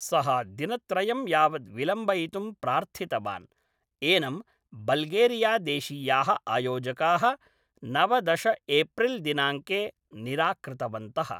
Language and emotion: Sanskrit, neutral